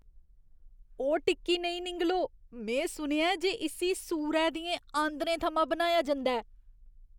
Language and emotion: Dogri, disgusted